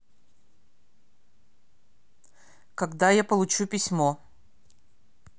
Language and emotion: Russian, angry